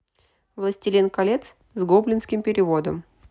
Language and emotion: Russian, neutral